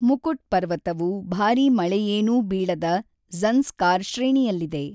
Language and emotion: Kannada, neutral